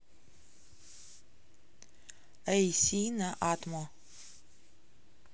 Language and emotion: Russian, neutral